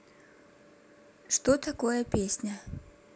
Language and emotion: Russian, neutral